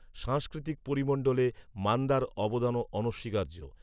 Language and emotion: Bengali, neutral